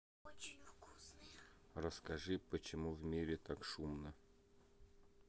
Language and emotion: Russian, neutral